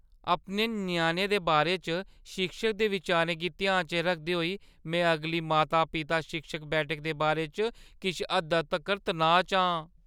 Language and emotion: Dogri, fearful